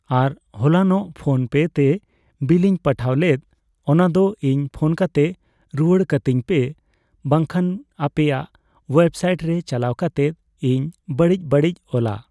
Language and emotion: Santali, neutral